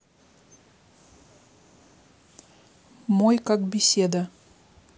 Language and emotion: Russian, neutral